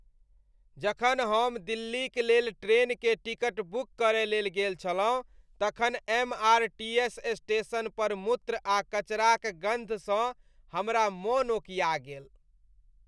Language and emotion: Maithili, disgusted